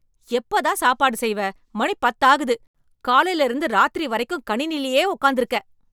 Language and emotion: Tamil, angry